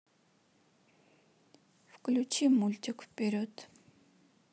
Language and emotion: Russian, neutral